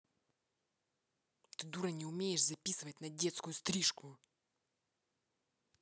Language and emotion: Russian, angry